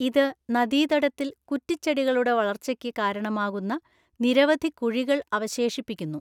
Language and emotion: Malayalam, neutral